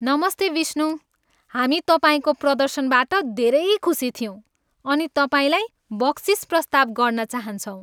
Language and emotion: Nepali, happy